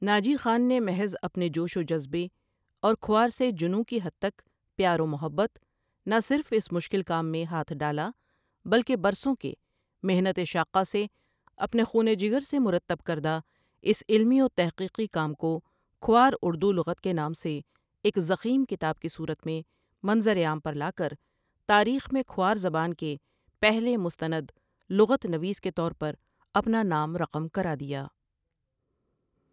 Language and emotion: Urdu, neutral